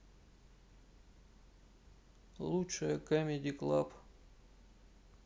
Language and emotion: Russian, neutral